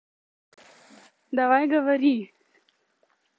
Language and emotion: Russian, neutral